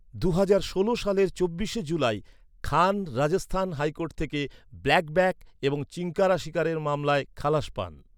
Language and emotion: Bengali, neutral